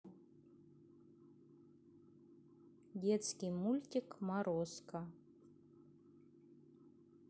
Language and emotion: Russian, neutral